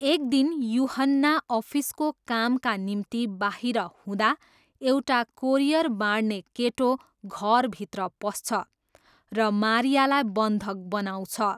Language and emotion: Nepali, neutral